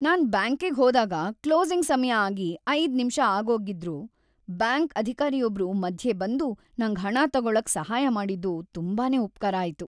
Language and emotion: Kannada, happy